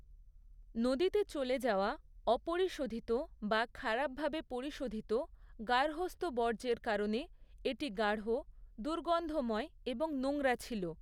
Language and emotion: Bengali, neutral